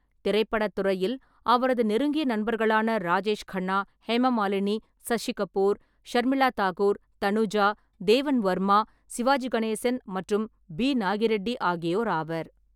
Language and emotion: Tamil, neutral